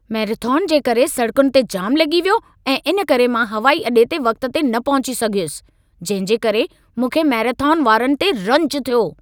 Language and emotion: Sindhi, angry